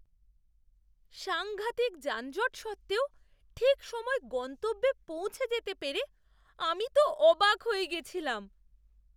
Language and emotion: Bengali, surprised